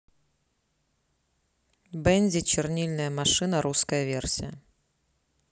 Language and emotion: Russian, neutral